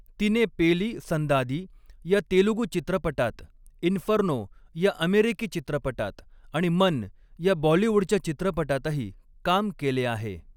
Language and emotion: Marathi, neutral